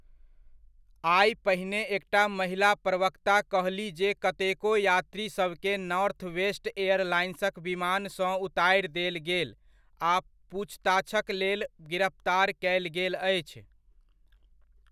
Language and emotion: Maithili, neutral